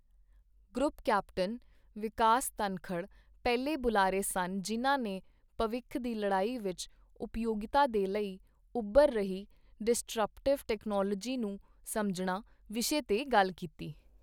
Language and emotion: Punjabi, neutral